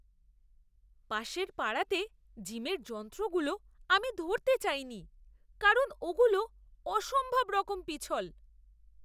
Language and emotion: Bengali, disgusted